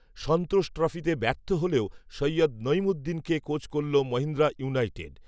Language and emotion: Bengali, neutral